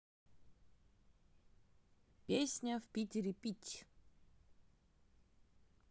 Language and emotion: Russian, neutral